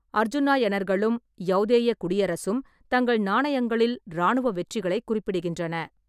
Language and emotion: Tamil, neutral